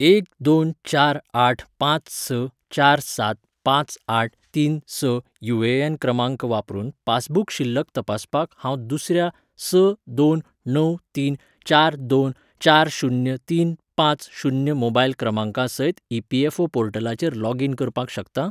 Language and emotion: Goan Konkani, neutral